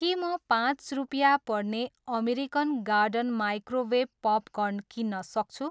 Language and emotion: Nepali, neutral